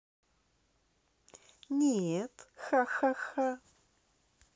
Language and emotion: Russian, positive